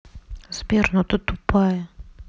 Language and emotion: Russian, neutral